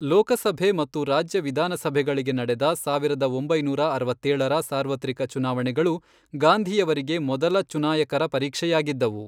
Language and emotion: Kannada, neutral